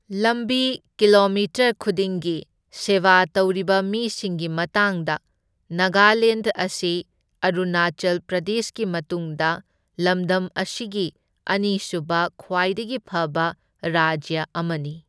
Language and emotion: Manipuri, neutral